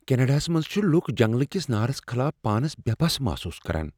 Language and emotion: Kashmiri, fearful